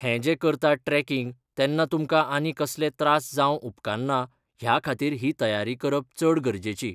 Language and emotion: Goan Konkani, neutral